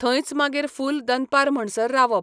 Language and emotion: Goan Konkani, neutral